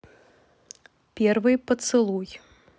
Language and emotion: Russian, neutral